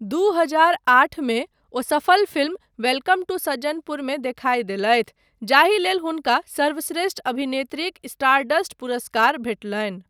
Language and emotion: Maithili, neutral